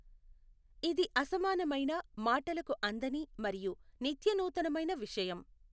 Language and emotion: Telugu, neutral